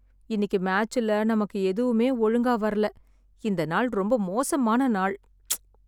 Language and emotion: Tamil, sad